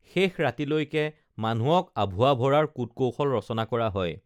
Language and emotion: Assamese, neutral